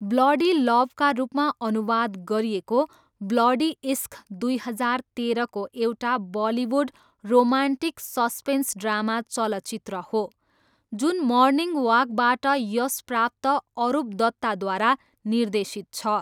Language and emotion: Nepali, neutral